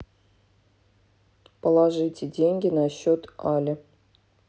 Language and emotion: Russian, neutral